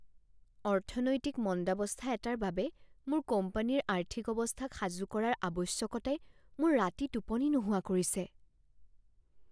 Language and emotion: Assamese, fearful